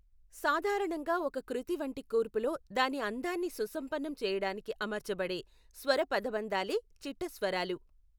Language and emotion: Telugu, neutral